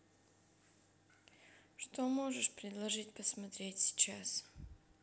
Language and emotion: Russian, neutral